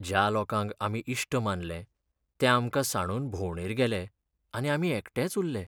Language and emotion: Goan Konkani, sad